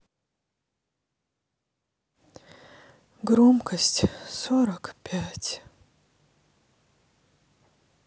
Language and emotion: Russian, sad